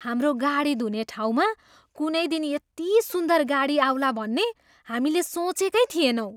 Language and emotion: Nepali, surprised